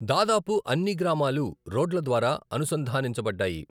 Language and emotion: Telugu, neutral